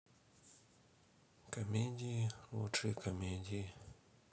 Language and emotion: Russian, neutral